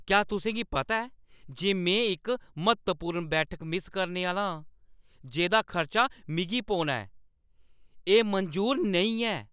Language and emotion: Dogri, angry